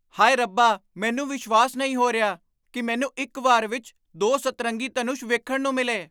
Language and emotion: Punjabi, surprised